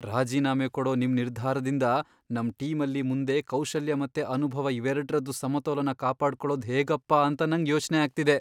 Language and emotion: Kannada, fearful